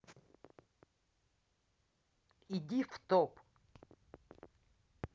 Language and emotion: Russian, angry